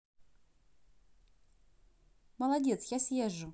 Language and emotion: Russian, positive